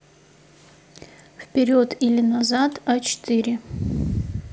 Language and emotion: Russian, neutral